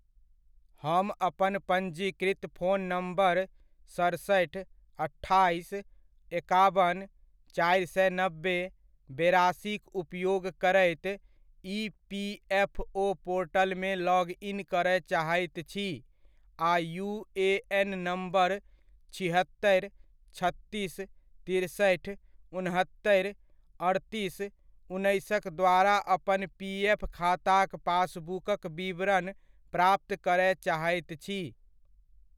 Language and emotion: Maithili, neutral